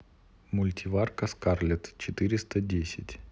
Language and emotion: Russian, neutral